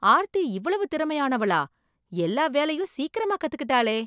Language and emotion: Tamil, surprised